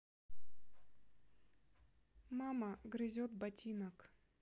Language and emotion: Russian, neutral